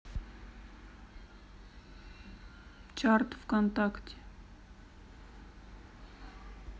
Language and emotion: Russian, neutral